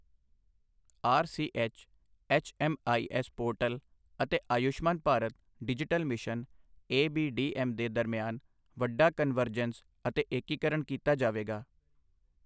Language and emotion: Punjabi, neutral